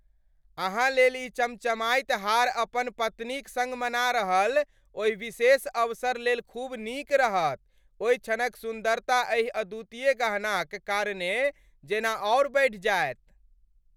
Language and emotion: Maithili, happy